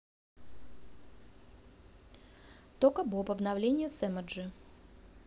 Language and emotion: Russian, neutral